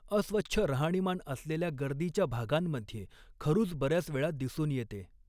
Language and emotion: Marathi, neutral